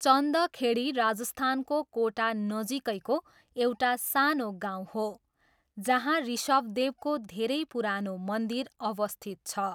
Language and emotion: Nepali, neutral